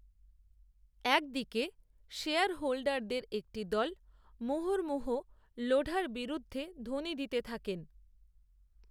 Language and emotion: Bengali, neutral